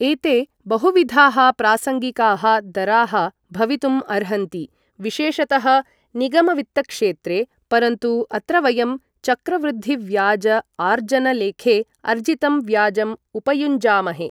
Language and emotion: Sanskrit, neutral